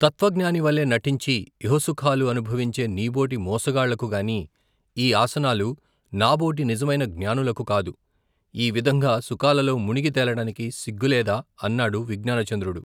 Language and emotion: Telugu, neutral